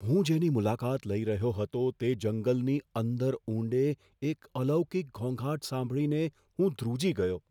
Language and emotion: Gujarati, fearful